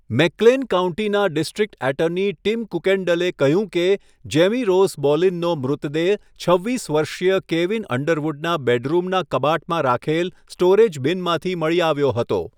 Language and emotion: Gujarati, neutral